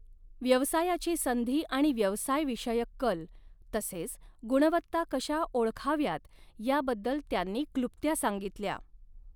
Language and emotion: Marathi, neutral